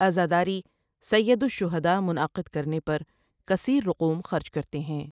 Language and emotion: Urdu, neutral